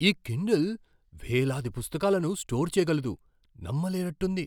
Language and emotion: Telugu, surprised